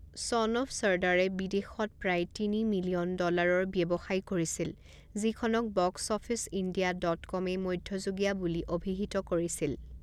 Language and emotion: Assamese, neutral